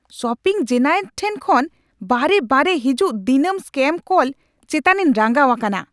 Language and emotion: Santali, angry